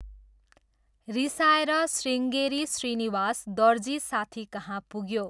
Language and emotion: Nepali, neutral